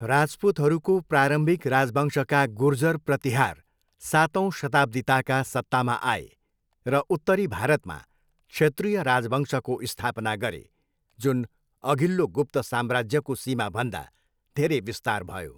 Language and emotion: Nepali, neutral